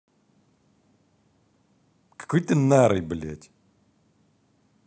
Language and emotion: Russian, angry